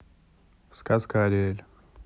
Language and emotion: Russian, neutral